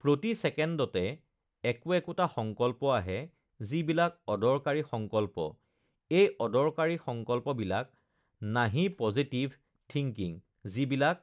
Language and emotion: Assamese, neutral